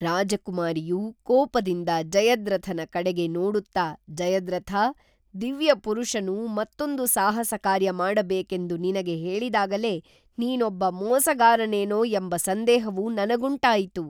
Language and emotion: Kannada, neutral